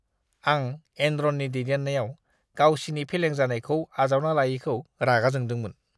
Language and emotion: Bodo, disgusted